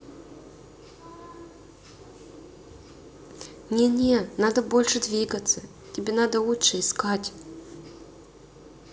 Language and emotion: Russian, neutral